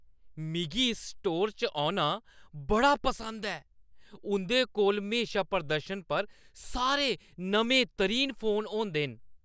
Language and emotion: Dogri, happy